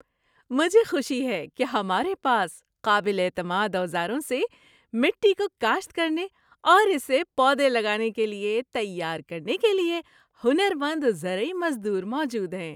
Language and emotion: Urdu, happy